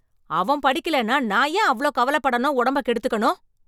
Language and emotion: Tamil, angry